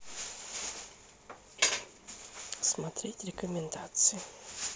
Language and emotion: Russian, neutral